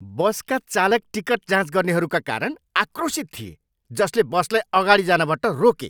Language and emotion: Nepali, angry